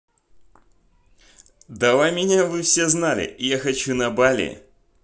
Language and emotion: Russian, positive